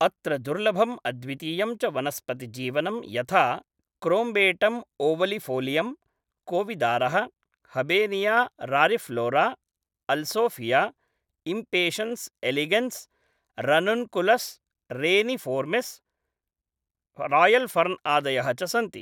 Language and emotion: Sanskrit, neutral